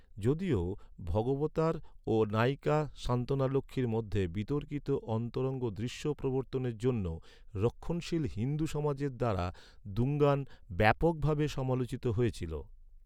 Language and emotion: Bengali, neutral